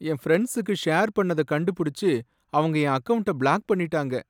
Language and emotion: Tamil, sad